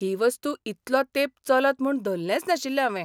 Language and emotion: Goan Konkani, surprised